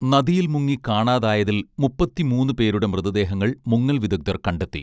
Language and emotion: Malayalam, neutral